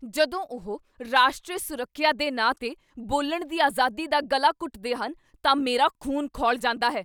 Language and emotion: Punjabi, angry